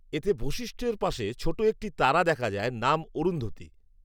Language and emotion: Bengali, neutral